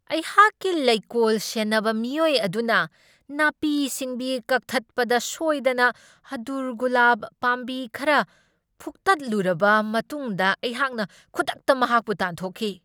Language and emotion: Manipuri, angry